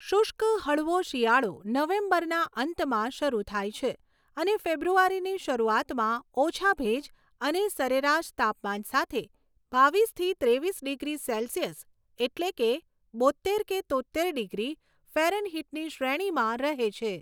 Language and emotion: Gujarati, neutral